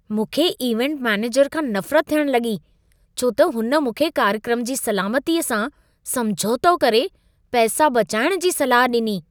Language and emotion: Sindhi, disgusted